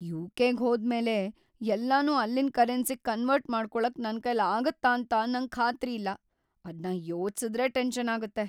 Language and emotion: Kannada, fearful